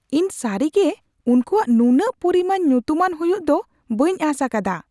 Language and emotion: Santali, surprised